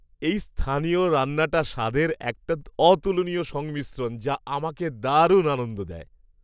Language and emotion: Bengali, happy